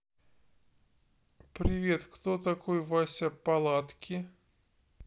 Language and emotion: Russian, neutral